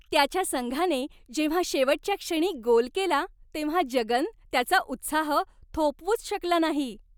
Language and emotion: Marathi, happy